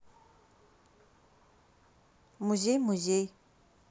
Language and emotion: Russian, neutral